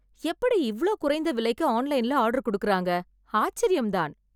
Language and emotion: Tamil, surprised